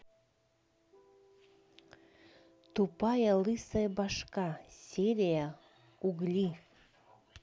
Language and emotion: Russian, neutral